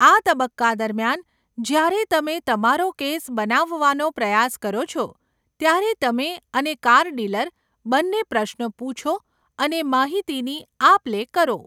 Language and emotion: Gujarati, neutral